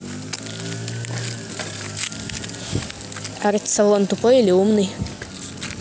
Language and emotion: Russian, neutral